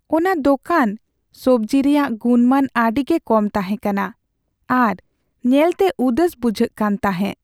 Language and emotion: Santali, sad